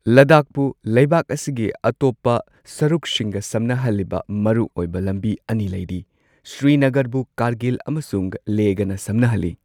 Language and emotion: Manipuri, neutral